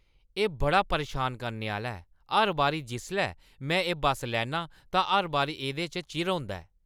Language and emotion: Dogri, angry